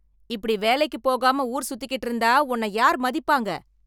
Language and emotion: Tamil, angry